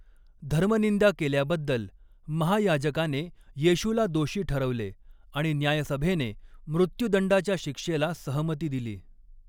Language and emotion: Marathi, neutral